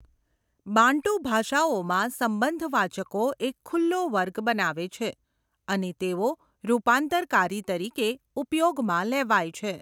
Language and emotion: Gujarati, neutral